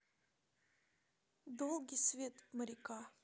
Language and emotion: Russian, neutral